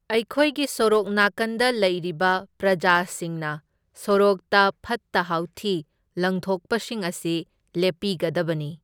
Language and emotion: Manipuri, neutral